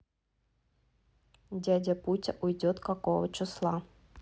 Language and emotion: Russian, neutral